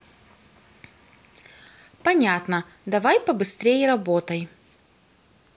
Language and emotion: Russian, neutral